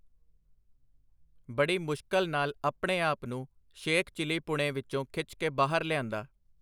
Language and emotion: Punjabi, neutral